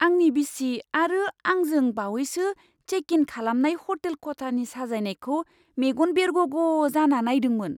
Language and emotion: Bodo, surprised